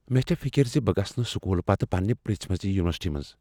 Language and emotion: Kashmiri, fearful